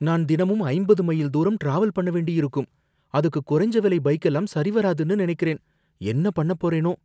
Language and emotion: Tamil, fearful